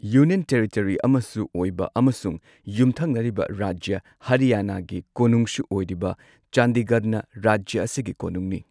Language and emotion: Manipuri, neutral